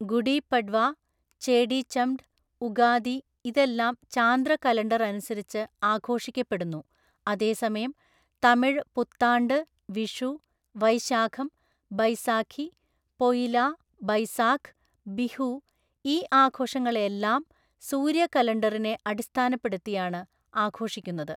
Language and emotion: Malayalam, neutral